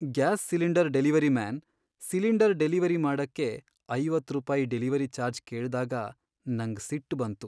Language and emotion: Kannada, sad